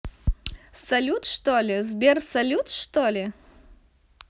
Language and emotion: Russian, neutral